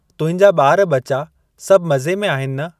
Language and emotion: Sindhi, neutral